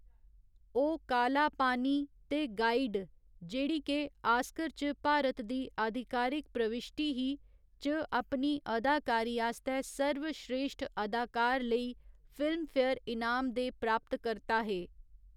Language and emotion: Dogri, neutral